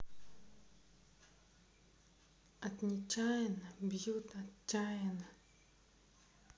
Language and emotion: Russian, neutral